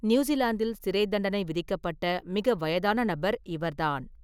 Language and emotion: Tamil, neutral